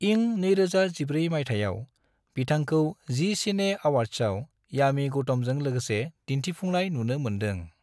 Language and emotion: Bodo, neutral